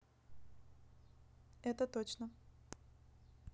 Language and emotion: Russian, neutral